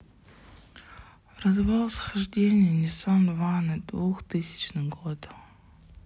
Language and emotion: Russian, sad